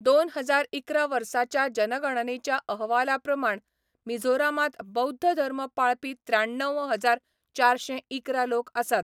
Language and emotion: Goan Konkani, neutral